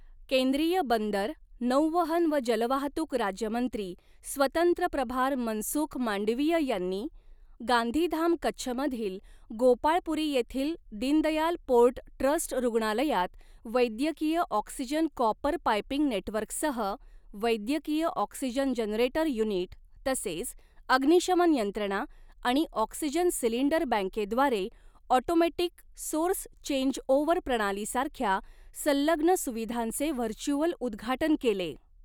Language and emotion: Marathi, neutral